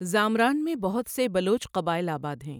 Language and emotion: Urdu, neutral